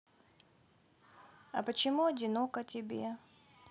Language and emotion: Russian, sad